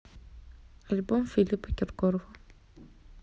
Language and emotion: Russian, neutral